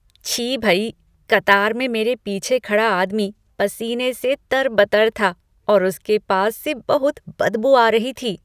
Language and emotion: Hindi, disgusted